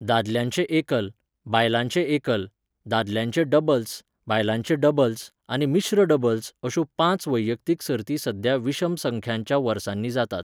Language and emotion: Goan Konkani, neutral